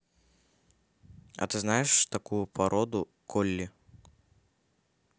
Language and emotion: Russian, neutral